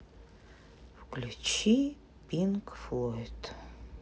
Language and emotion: Russian, sad